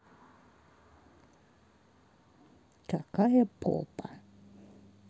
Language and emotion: Russian, neutral